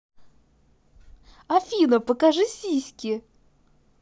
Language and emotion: Russian, positive